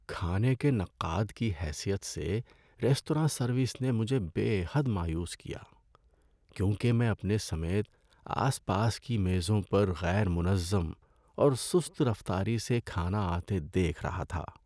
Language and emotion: Urdu, sad